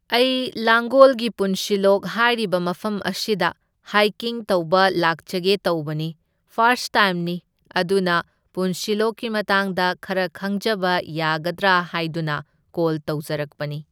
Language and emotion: Manipuri, neutral